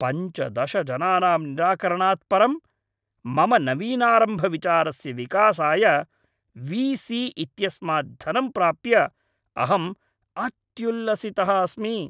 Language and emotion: Sanskrit, happy